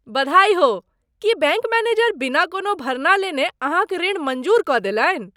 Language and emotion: Maithili, surprised